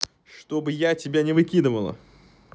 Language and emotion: Russian, angry